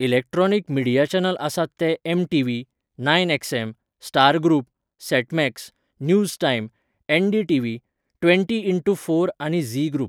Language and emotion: Goan Konkani, neutral